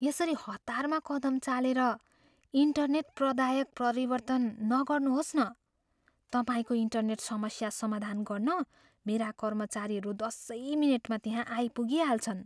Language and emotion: Nepali, fearful